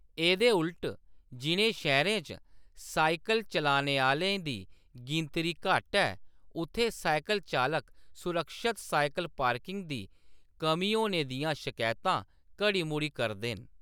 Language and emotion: Dogri, neutral